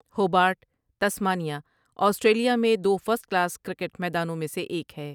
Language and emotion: Urdu, neutral